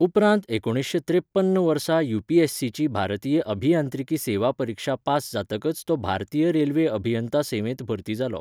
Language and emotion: Goan Konkani, neutral